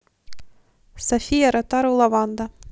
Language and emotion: Russian, neutral